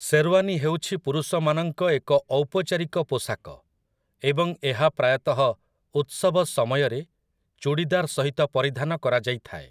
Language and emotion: Odia, neutral